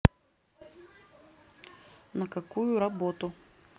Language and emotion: Russian, neutral